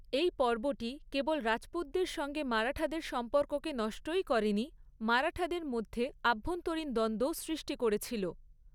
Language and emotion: Bengali, neutral